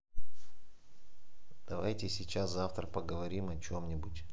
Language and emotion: Russian, neutral